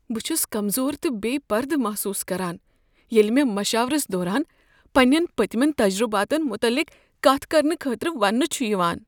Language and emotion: Kashmiri, fearful